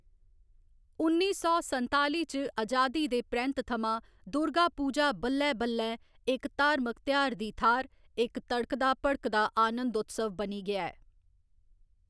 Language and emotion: Dogri, neutral